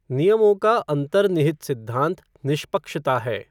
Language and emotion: Hindi, neutral